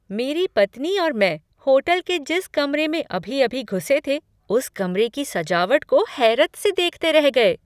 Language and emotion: Hindi, surprised